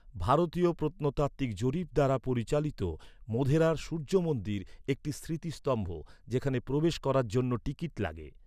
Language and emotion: Bengali, neutral